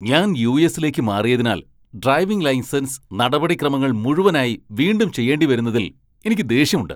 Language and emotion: Malayalam, angry